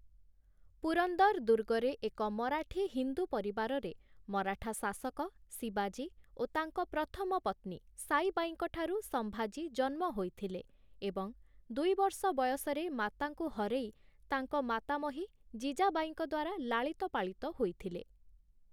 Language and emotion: Odia, neutral